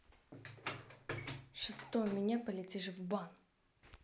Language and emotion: Russian, angry